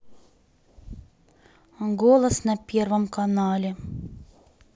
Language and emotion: Russian, sad